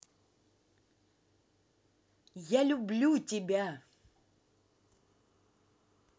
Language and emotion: Russian, positive